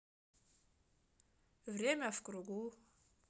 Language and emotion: Russian, neutral